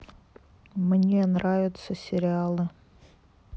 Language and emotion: Russian, sad